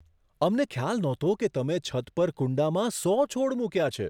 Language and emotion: Gujarati, surprised